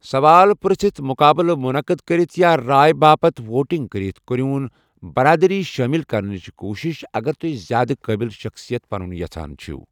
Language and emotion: Kashmiri, neutral